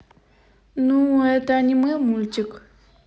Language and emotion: Russian, neutral